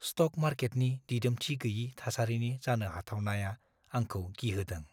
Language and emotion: Bodo, fearful